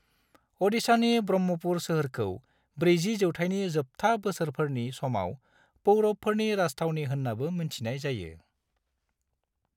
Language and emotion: Bodo, neutral